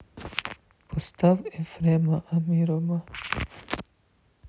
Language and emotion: Russian, sad